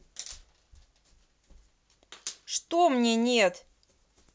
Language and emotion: Russian, angry